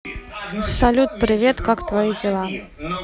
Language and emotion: Russian, neutral